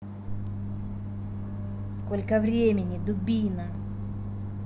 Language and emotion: Russian, angry